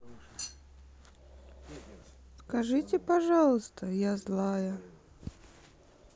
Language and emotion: Russian, sad